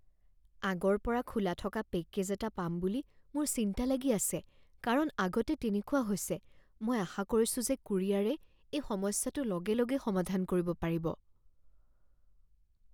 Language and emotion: Assamese, fearful